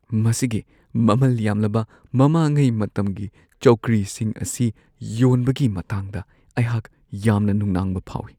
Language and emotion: Manipuri, fearful